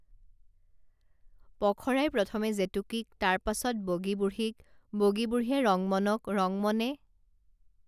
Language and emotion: Assamese, neutral